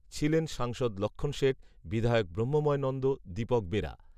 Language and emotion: Bengali, neutral